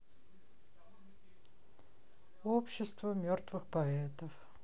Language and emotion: Russian, sad